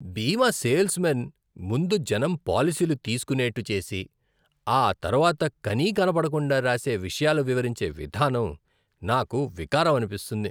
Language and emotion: Telugu, disgusted